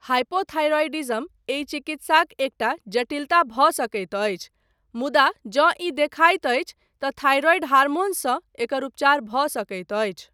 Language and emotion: Maithili, neutral